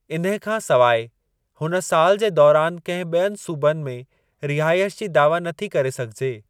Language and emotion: Sindhi, neutral